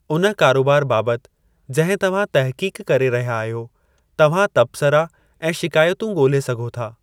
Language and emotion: Sindhi, neutral